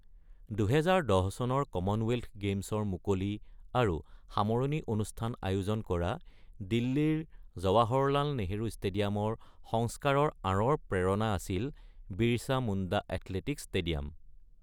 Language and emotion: Assamese, neutral